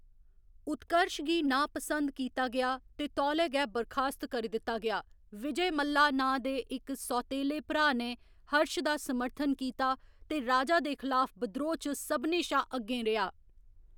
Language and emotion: Dogri, neutral